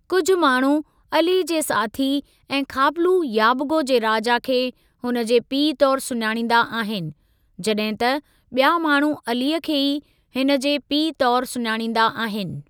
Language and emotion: Sindhi, neutral